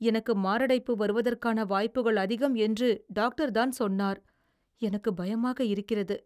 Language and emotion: Tamil, fearful